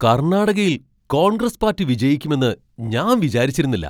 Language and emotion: Malayalam, surprised